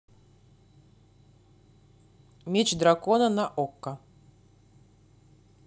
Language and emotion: Russian, neutral